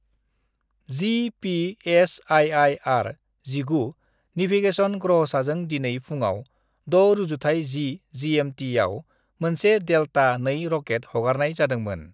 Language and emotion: Bodo, neutral